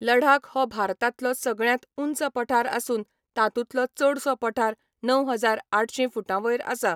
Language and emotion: Goan Konkani, neutral